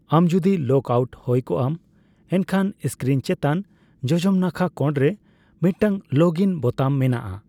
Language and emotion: Santali, neutral